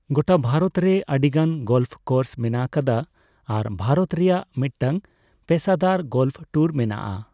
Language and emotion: Santali, neutral